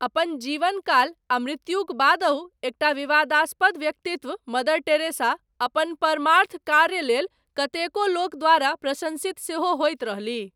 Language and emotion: Maithili, neutral